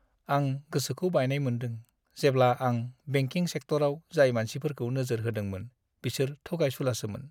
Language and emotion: Bodo, sad